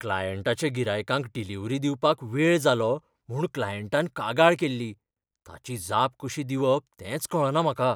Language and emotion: Goan Konkani, fearful